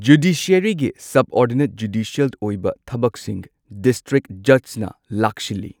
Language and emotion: Manipuri, neutral